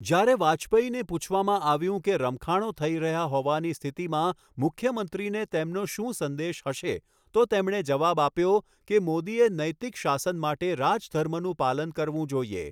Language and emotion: Gujarati, neutral